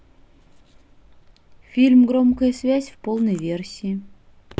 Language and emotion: Russian, neutral